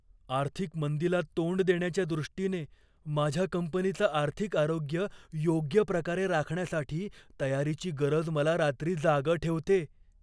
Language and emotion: Marathi, fearful